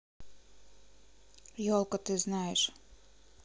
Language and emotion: Russian, neutral